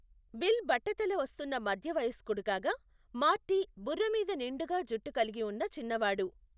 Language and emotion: Telugu, neutral